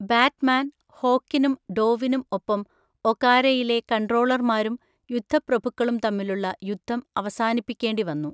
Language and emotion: Malayalam, neutral